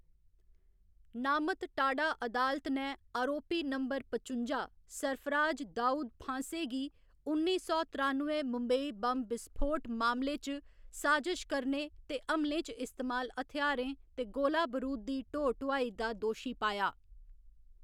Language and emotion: Dogri, neutral